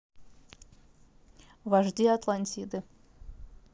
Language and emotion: Russian, neutral